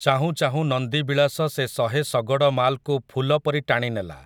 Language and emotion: Odia, neutral